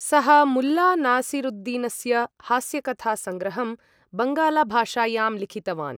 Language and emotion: Sanskrit, neutral